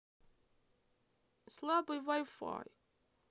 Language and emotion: Russian, sad